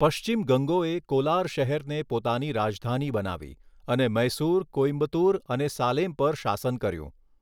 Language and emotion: Gujarati, neutral